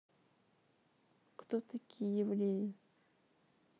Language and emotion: Russian, neutral